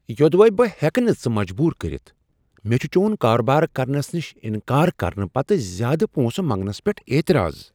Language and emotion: Kashmiri, surprised